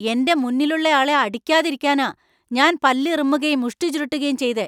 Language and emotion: Malayalam, angry